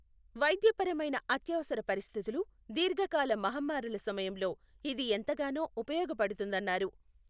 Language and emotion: Telugu, neutral